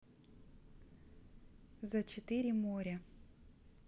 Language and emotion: Russian, neutral